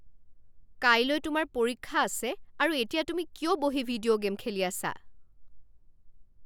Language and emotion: Assamese, angry